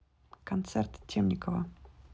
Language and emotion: Russian, neutral